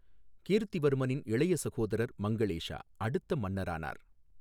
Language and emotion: Tamil, neutral